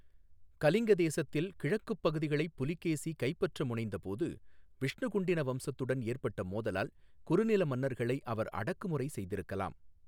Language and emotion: Tamil, neutral